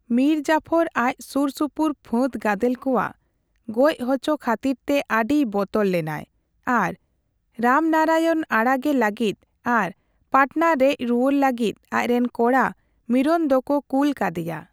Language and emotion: Santali, neutral